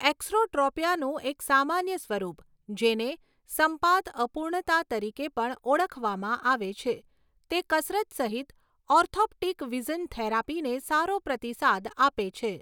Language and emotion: Gujarati, neutral